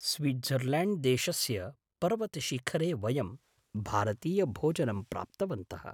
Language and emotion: Sanskrit, surprised